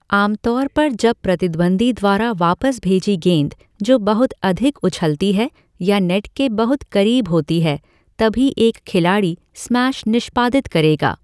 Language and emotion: Hindi, neutral